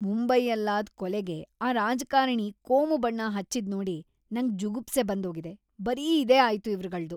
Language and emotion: Kannada, disgusted